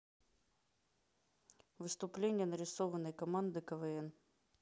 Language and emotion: Russian, neutral